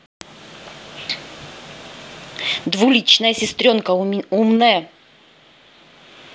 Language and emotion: Russian, angry